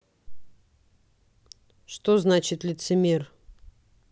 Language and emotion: Russian, neutral